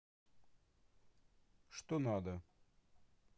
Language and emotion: Russian, neutral